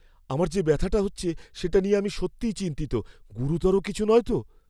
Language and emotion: Bengali, fearful